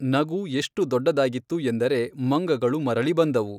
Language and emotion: Kannada, neutral